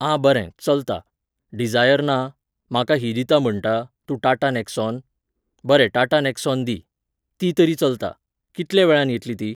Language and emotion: Goan Konkani, neutral